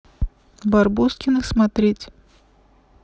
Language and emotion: Russian, neutral